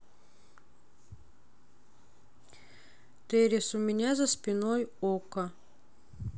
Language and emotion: Russian, sad